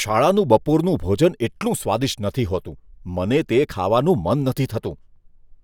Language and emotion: Gujarati, disgusted